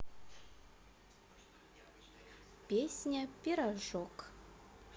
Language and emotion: Russian, neutral